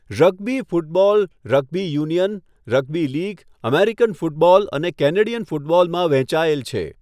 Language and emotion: Gujarati, neutral